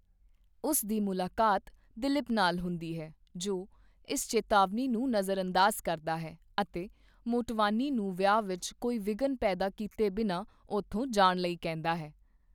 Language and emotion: Punjabi, neutral